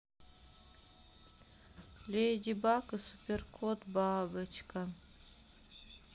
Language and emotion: Russian, sad